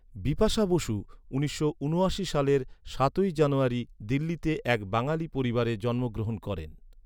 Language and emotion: Bengali, neutral